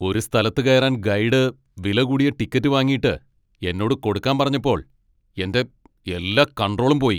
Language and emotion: Malayalam, angry